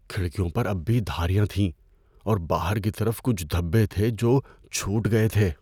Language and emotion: Urdu, fearful